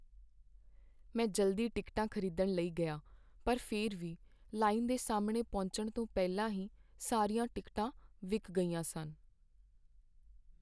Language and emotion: Punjabi, sad